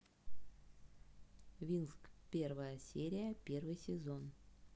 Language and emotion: Russian, neutral